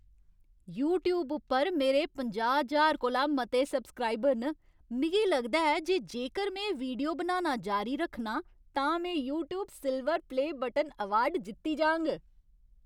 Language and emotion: Dogri, happy